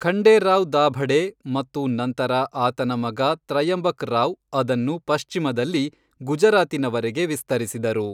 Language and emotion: Kannada, neutral